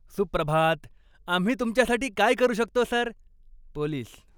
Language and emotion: Marathi, happy